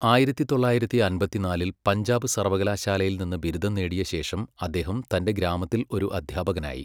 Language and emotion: Malayalam, neutral